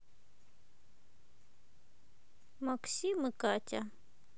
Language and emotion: Russian, neutral